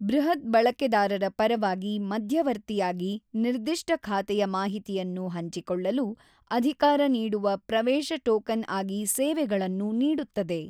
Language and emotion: Kannada, neutral